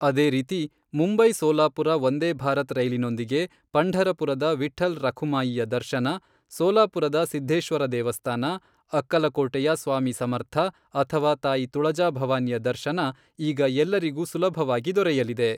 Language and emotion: Kannada, neutral